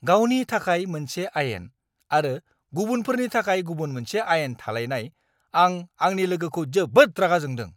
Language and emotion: Bodo, angry